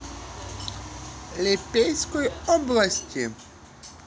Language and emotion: Russian, positive